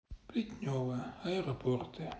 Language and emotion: Russian, sad